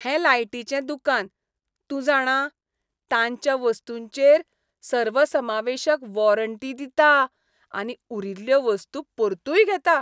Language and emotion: Goan Konkani, happy